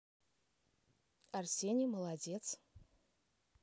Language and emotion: Russian, positive